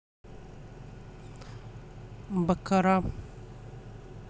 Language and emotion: Russian, neutral